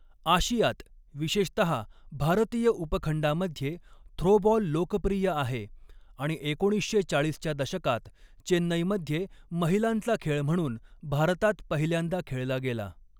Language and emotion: Marathi, neutral